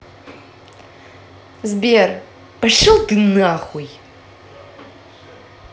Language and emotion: Russian, angry